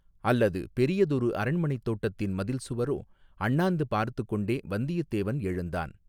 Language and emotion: Tamil, neutral